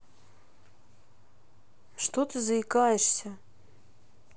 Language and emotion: Russian, neutral